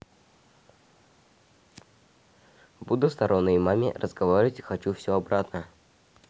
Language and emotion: Russian, neutral